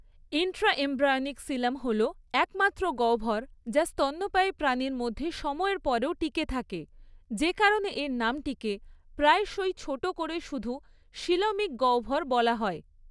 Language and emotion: Bengali, neutral